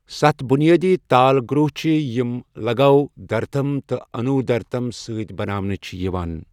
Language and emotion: Kashmiri, neutral